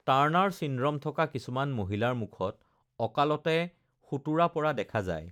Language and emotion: Assamese, neutral